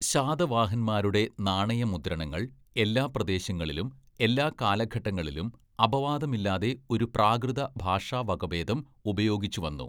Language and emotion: Malayalam, neutral